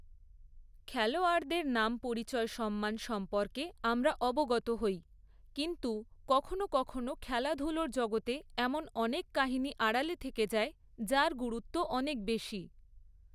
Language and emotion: Bengali, neutral